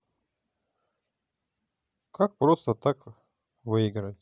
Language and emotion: Russian, neutral